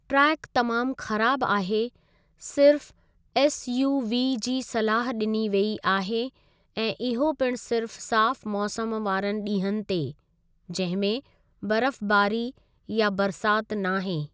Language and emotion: Sindhi, neutral